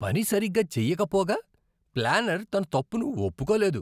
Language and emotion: Telugu, disgusted